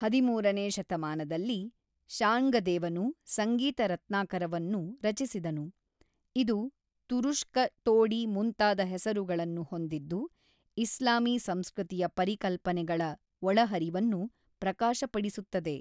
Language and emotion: Kannada, neutral